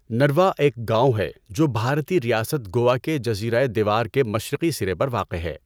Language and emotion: Urdu, neutral